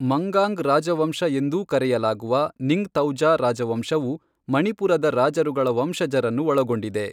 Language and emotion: Kannada, neutral